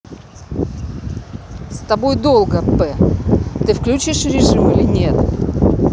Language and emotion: Russian, angry